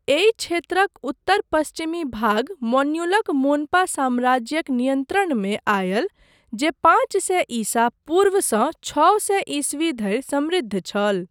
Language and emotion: Maithili, neutral